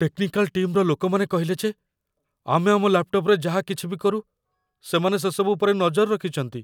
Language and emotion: Odia, fearful